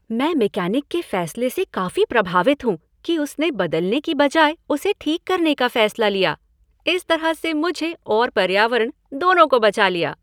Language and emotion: Hindi, happy